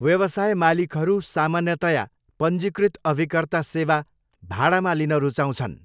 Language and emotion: Nepali, neutral